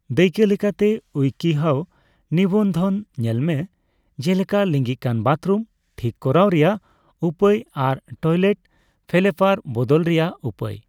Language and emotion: Santali, neutral